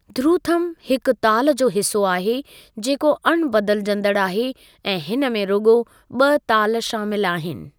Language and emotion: Sindhi, neutral